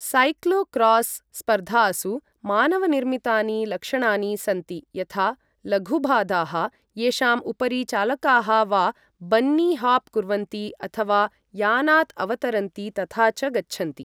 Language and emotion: Sanskrit, neutral